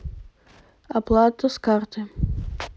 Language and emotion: Russian, neutral